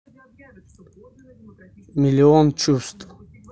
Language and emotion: Russian, neutral